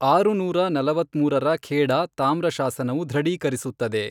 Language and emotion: Kannada, neutral